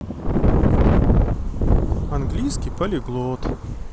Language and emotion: Russian, neutral